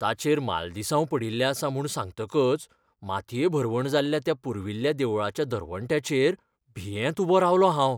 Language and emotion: Goan Konkani, fearful